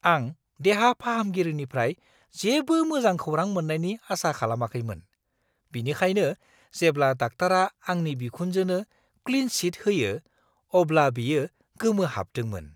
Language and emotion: Bodo, surprised